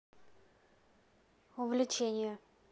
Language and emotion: Russian, neutral